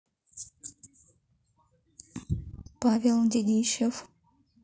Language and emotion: Russian, neutral